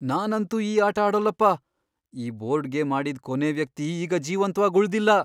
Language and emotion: Kannada, fearful